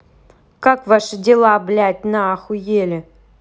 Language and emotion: Russian, angry